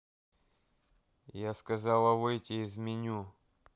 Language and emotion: Russian, angry